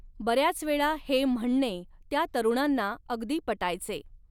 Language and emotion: Marathi, neutral